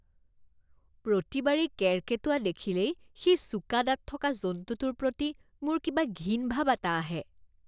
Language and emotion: Assamese, disgusted